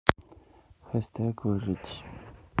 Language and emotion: Russian, neutral